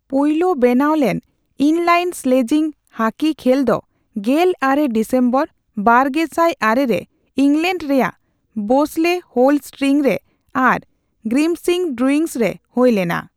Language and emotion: Santali, neutral